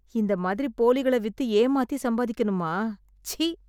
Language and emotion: Tamil, disgusted